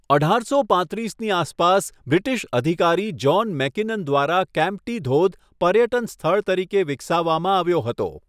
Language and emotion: Gujarati, neutral